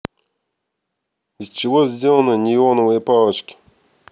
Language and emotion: Russian, neutral